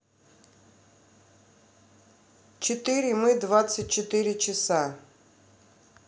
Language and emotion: Russian, neutral